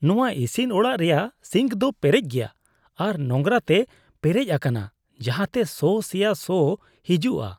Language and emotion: Santali, disgusted